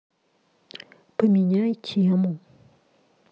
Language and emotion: Russian, neutral